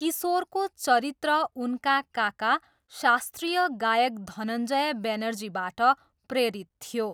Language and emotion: Nepali, neutral